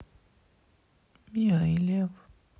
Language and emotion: Russian, sad